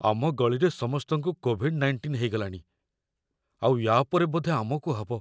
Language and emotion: Odia, fearful